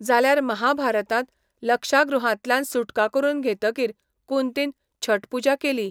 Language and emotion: Goan Konkani, neutral